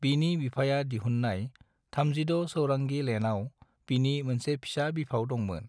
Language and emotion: Bodo, neutral